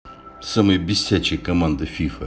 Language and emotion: Russian, angry